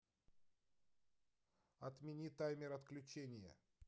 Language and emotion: Russian, neutral